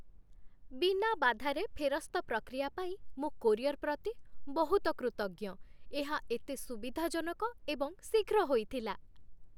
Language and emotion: Odia, happy